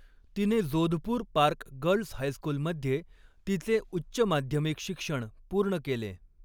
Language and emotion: Marathi, neutral